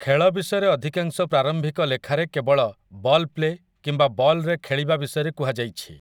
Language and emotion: Odia, neutral